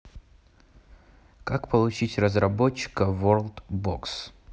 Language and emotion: Russian, neutral